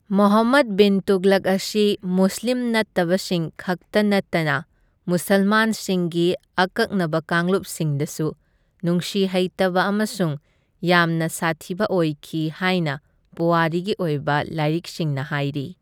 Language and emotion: Manipuri, neutral